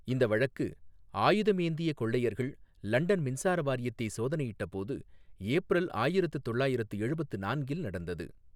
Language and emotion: Tamil, neutral